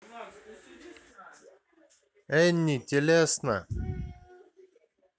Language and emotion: Russian, neutral